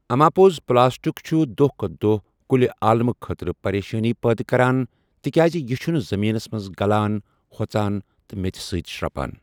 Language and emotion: Kashmiri, neutral